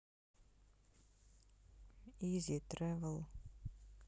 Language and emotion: Russian, neutral